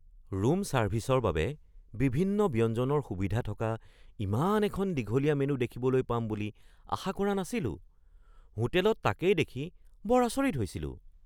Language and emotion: Assamese, surprised